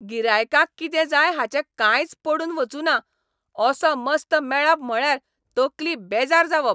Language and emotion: Goan Konkani, angry